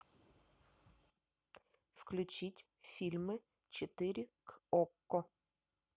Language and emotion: Russian, neutral